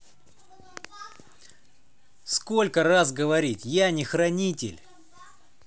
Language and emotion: Russian, angry